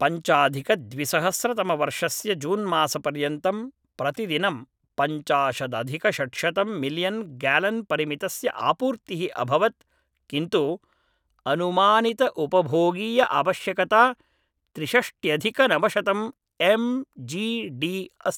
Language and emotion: Sanskrit, neutral